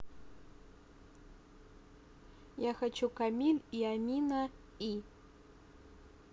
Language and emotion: Russian, neutral